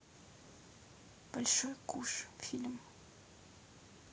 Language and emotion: Russian, neutral